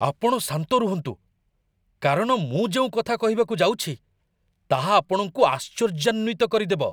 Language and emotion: Odia, surprised